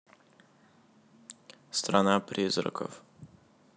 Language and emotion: Russian, neutral